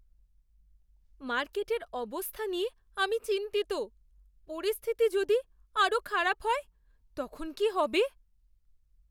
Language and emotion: Bengali, fearful